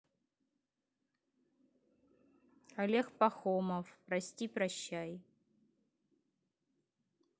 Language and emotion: Russian, neutral